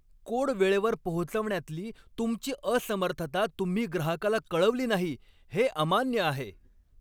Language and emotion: Marathi, angry